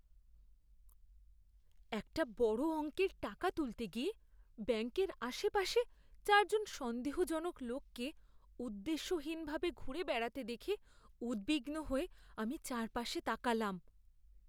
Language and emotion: Bengali, fearful